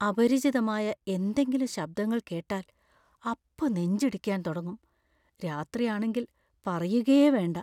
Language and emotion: Malayalam, fearful